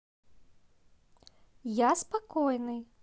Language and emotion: Russian, positive